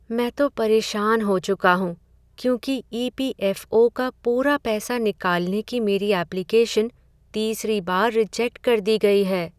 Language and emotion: Hindi, sad